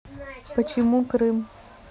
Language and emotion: Russian, neutral